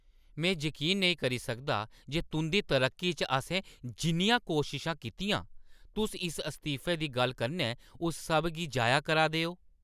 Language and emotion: Dogri, angry